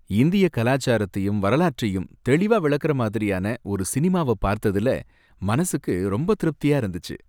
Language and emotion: Tamil, happy